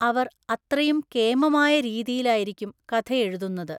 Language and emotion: Malayalam, neutral